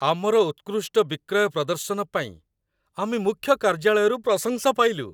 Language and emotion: Odia, happy